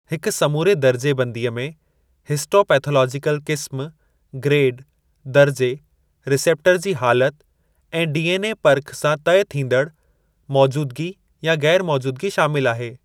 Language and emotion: Sindhi, neutral